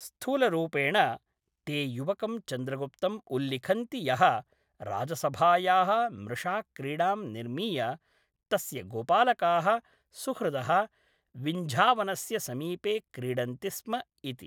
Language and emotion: Sanskrit, neutral